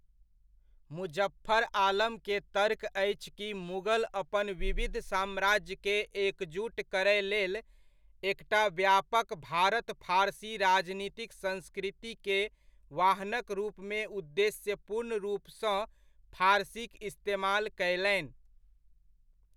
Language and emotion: Maithili, neutral